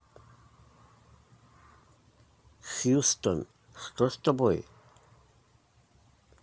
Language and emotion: Russian, neutral